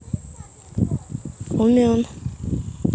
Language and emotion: Russian, neutral